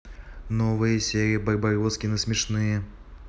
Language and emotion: Russian, neutral